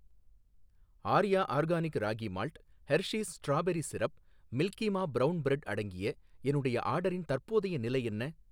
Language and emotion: Tamil, neutral